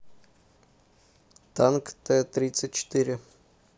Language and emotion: Russian, neutral